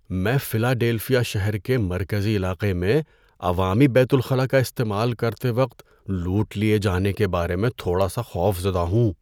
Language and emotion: Urdu, fearful